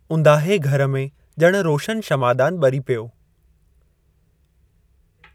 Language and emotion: Sindhi, neutral